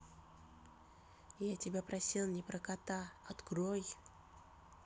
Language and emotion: Russian, neutral